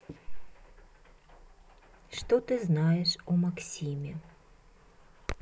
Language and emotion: Russian, neutral